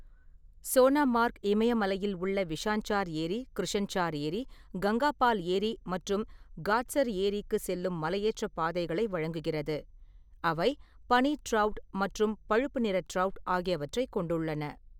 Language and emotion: Tamil, neutral